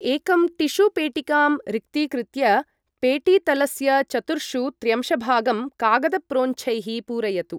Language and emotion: Sanskrit, neutral